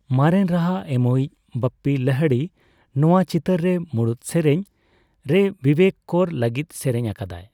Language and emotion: Santali, neutral